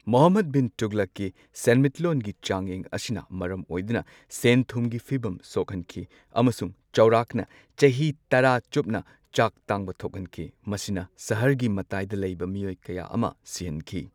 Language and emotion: Manipuri, neutral